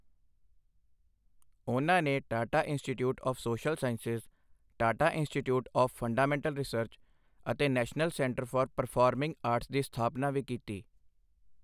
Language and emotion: Punjabi, neutral